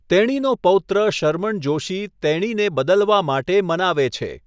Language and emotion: Gujarati, neutral